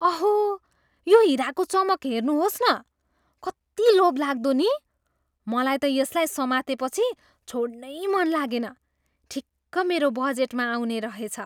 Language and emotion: Nepali, surprised